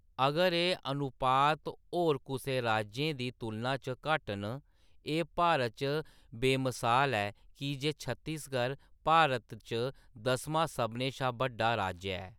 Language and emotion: Dogri, neutral